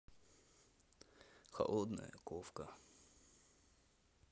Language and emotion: Russian, neutral